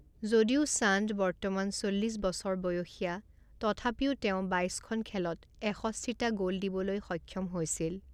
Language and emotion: Assamese, neutral